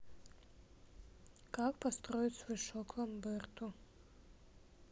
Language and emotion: Russian, neutral